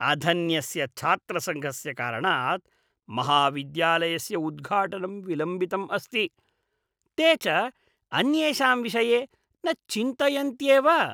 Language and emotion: Sanskrit, disgusted